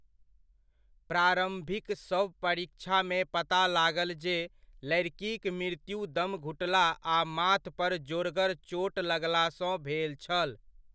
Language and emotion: Maithili, neutral